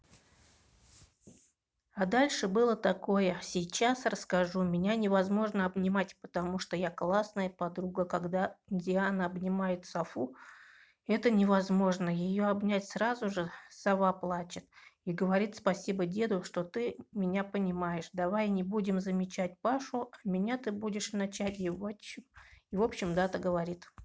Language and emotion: Russian, neutral